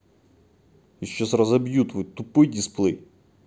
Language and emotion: Russian, angry